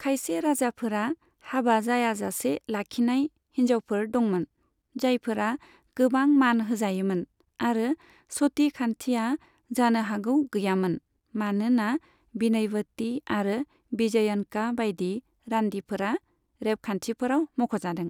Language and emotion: Bodo, neutral